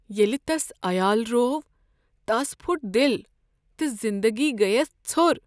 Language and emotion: Kashmiri, sad